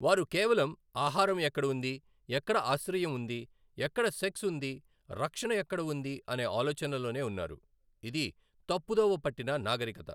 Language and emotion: Telugu, neutral